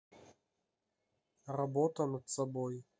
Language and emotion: Russian, neutral